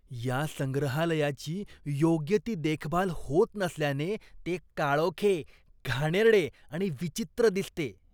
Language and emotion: Marathi, disgusted